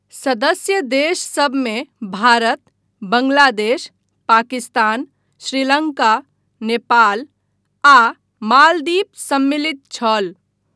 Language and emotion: Maithili, neutral